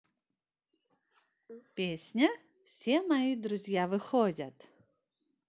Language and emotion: Russian, positive